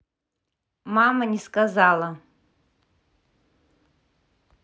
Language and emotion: Russian, neutral